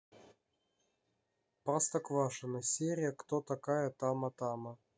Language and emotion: Russian, neutral